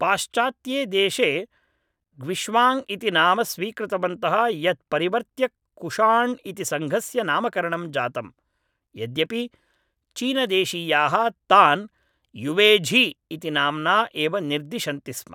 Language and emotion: Sanskrit, neutral